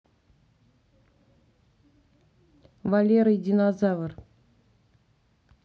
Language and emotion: Russian, neutral